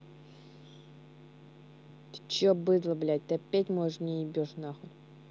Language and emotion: Russian, angry